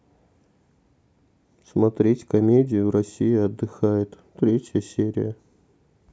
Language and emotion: Russian, sad